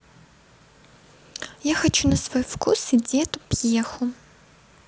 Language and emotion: Russian, neutral